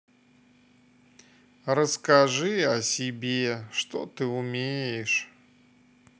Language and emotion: Russian, sad